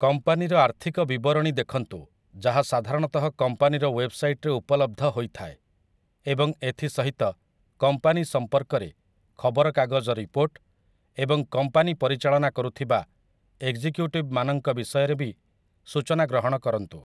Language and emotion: Odia, neutral